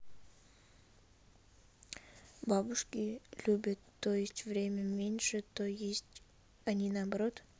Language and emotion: Russian, neutral